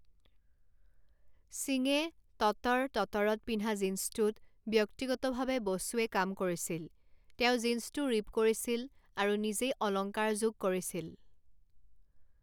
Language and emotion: Assamese, neutral